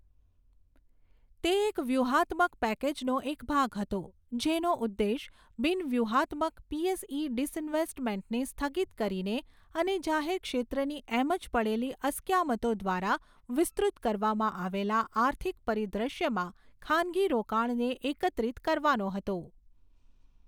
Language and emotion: Gujarati, neutral